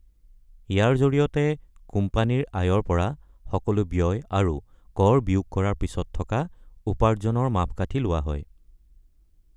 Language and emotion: Assamese, neutral